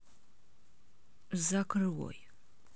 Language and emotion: Russian, angry